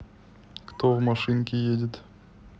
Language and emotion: Russian, neutral